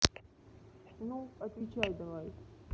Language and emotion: Russian, neutral